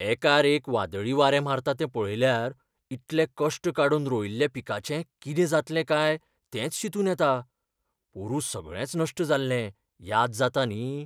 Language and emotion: Goan Konkani, fearful